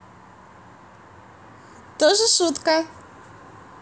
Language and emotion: Russian, positive